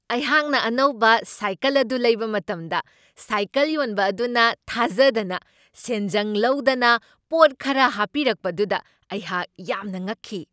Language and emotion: Manipuri, surprised